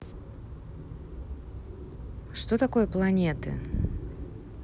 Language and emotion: Russian, neutral